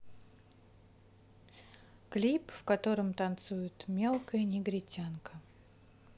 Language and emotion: Russian, neutral